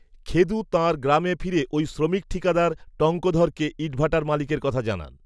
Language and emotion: Bengali, neutral